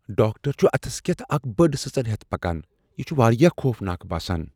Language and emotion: Kashmiri, fearful